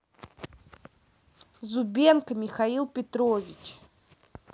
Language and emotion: Russian, neutral